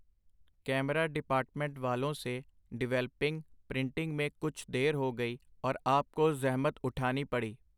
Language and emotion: Punjabi, neutral